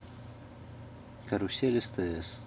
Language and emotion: Russian, neutral